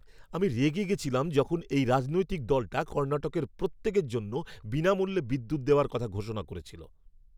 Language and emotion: Bengali, angry